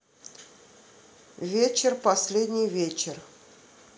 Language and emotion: Russian, neutral